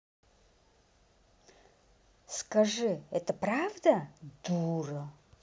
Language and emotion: Russian, angry